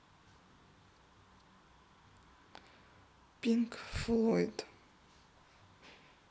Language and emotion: Russian, neutral